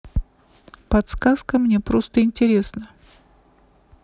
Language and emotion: Russian, neutral